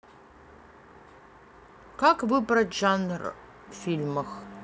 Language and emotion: Russian, neutral